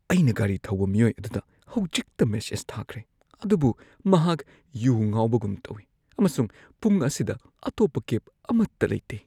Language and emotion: Manipuri, fearful